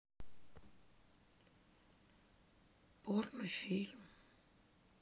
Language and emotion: Russian, sad